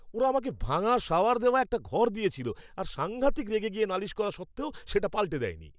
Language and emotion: Bengali, angry